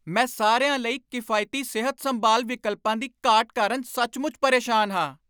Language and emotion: Punjabi, angry